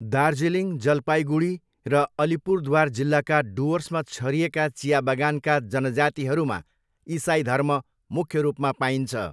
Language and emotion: Nepali, neutral